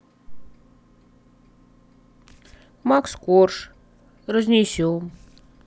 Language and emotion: Russian, sad